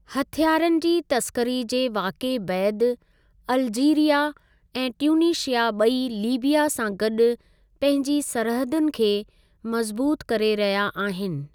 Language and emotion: Sindhi, neutral